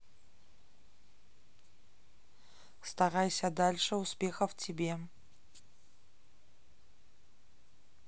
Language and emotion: Russian, neutral